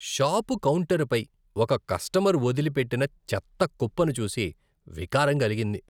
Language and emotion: Telugu, disgusted